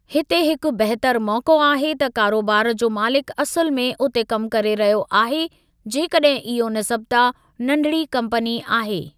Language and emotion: Sindhi, neutral